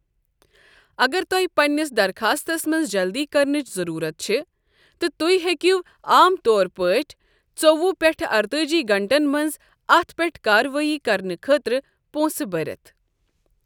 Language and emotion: Kashmiri, neutral